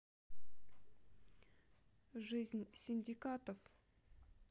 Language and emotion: Russian, neutral